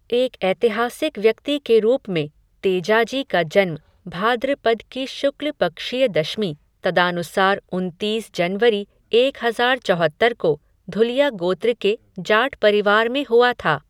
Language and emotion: Hindi, neutral